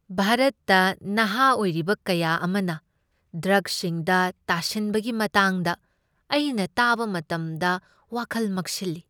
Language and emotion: Manipuri, sad